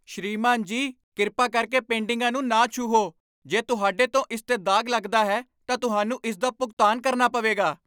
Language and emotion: Punjabi, angry